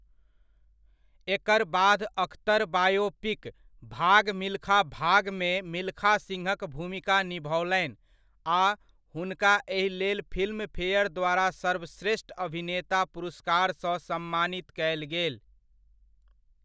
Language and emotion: Maithili, neutral